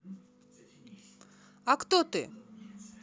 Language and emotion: Russian, neutral